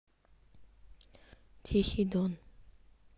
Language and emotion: Russian, neutral